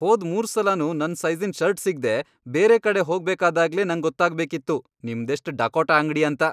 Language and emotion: Kannada, angry